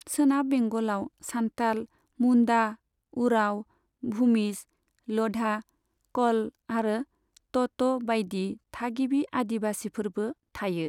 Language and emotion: Bodo, neutral